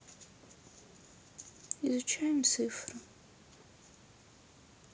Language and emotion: Russian, sad